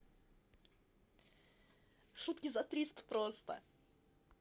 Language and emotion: Russian, positive